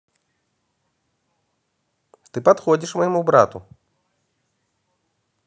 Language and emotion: Russian, positive